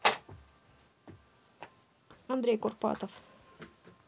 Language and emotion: Russian, neutral